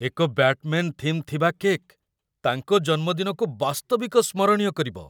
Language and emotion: Odia, surprised